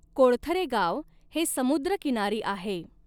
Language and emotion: Marathi, neutral